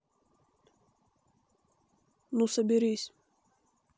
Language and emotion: Russian, neutral